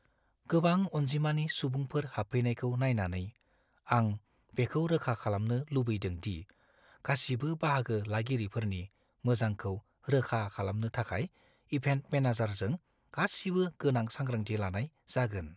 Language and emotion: Bodo, fearful